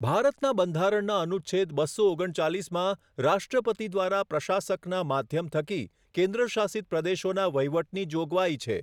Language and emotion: Gujarati, neutral